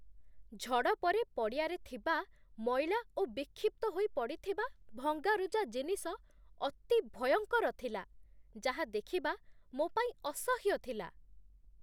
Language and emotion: Odia, disgusted